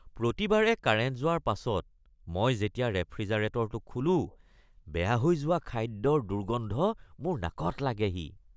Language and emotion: Assamese, disgusted